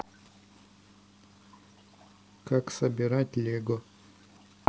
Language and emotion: Russian, neutral